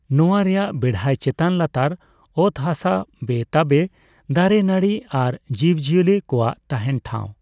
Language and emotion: Santali, neutral